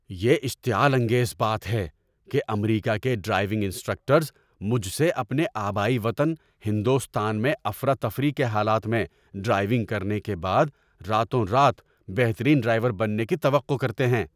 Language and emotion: Urdu, angry